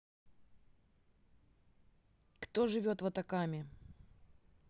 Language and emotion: Russian, neutral